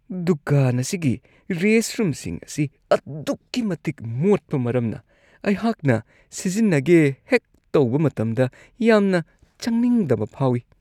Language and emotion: Manipuri, disgusted